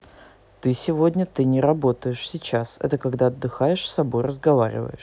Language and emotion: Russian, neutral